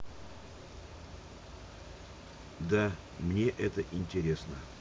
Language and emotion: Russian, neutral